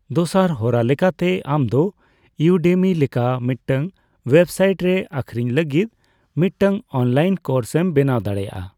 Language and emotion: Santali, neutral